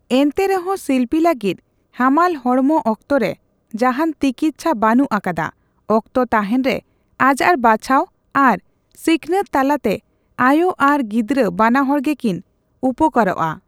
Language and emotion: Santali, neutral